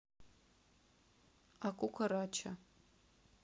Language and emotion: Russian, neutral